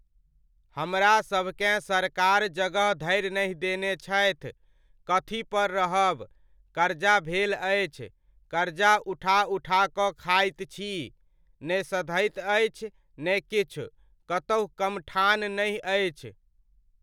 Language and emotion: Maithili, neutral